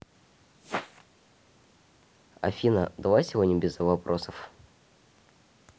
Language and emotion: Russian, neutral